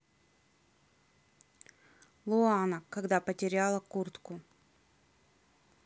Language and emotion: Russian, neutral